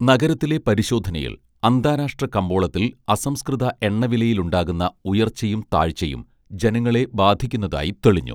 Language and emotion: Malayalam, neutral